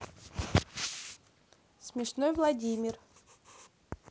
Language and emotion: Russian, neutral